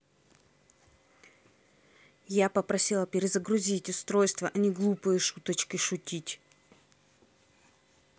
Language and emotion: Russian, angry